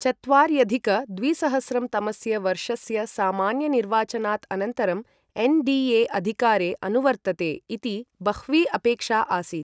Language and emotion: Sanskrit, neutral